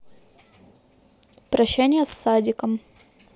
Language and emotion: Russian, neutral